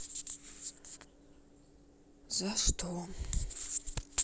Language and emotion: Russian, sad